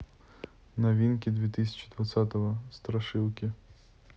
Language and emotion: Russian, neutral